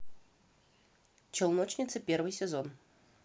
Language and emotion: Russian, positive